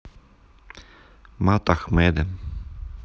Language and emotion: Russian, neutral